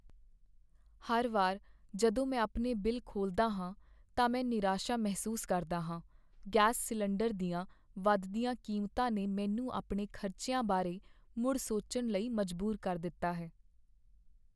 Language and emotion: Punjabi, sad